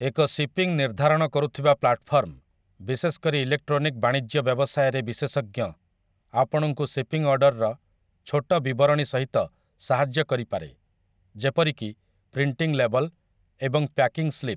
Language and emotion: Odia, neutral